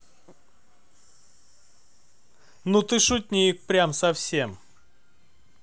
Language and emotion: Russian, positive